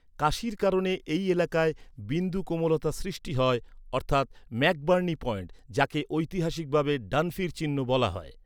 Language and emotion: Bengali, neutral